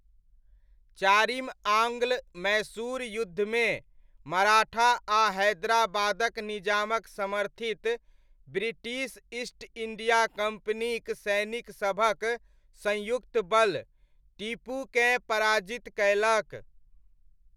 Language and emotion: Maithili, neutral